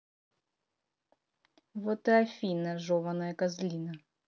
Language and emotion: Russian, angry